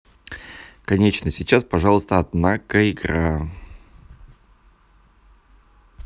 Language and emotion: Russian, neutral